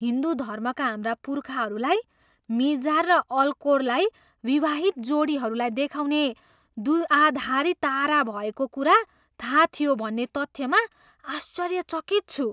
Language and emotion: Nepali, surprised